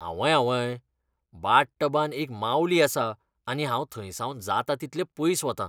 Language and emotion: Goan Konkani, disgusted